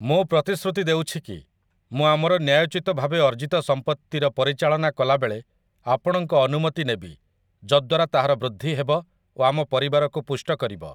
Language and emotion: Odia, neutral